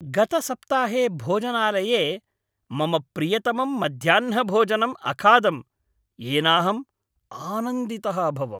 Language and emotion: Sanskrit, happy